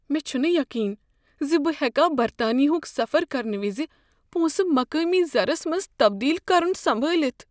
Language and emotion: Kashmiri, fearful